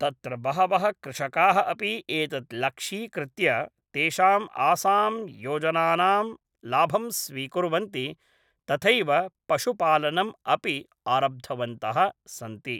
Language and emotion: Sanskrit, neutral